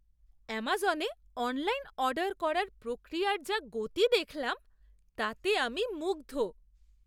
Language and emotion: Bengali, surprised